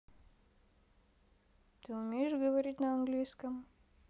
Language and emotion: Russian, neutral